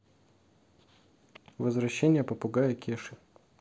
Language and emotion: Russian, neutral